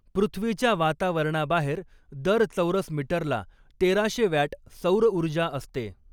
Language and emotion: Marathi, neutral